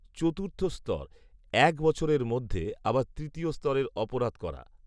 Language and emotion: Bengali, neutral